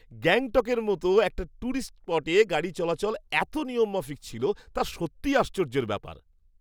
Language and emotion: Bengali, surprised